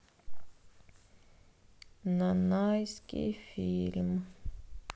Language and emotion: Russian, sad